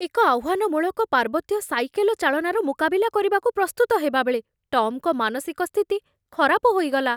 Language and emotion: Odia, fearful